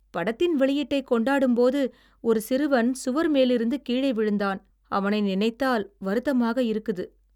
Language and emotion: Tamil, sad